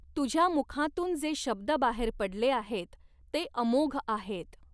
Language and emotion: Marathi, neutral